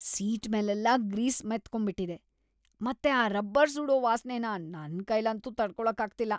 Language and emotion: Kannada, disgusted